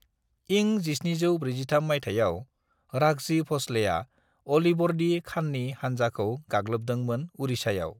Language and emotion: Bodo, neutral